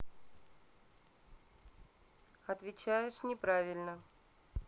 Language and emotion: Russian, neutral